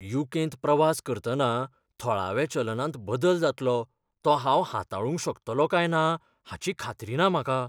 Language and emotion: Goan Konkani, fearful